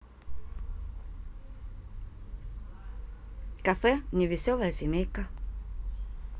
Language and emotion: Russian, neutral